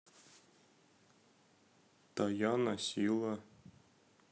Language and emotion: Russian, neutral